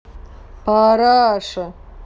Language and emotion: Russian, angry